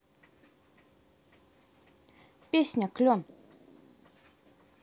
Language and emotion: Russian, neutral